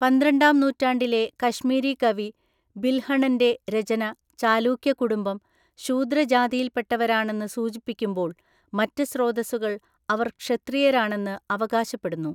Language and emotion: Malayalam, neutral